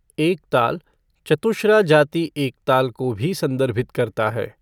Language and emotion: Hindi, neutral